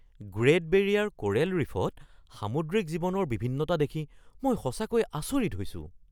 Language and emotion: Assamese, surprised